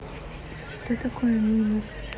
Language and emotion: Russian, neutral